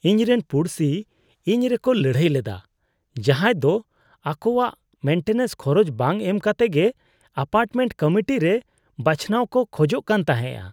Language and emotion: Santali, disgusted